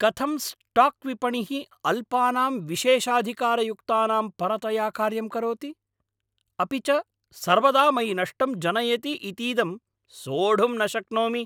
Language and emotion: Sanskrit, angry